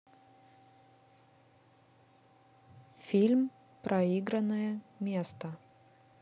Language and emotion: Russian, neutral